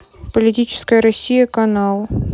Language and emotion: Russian, neutral